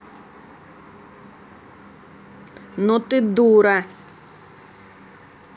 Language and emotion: Russian, angry